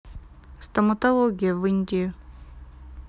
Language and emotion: Russian, neutral